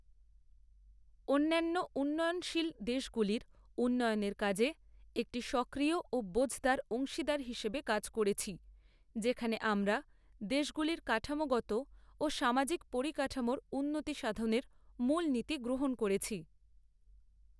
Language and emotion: Bengali, neutral